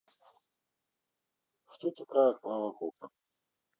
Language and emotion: Russian, neutral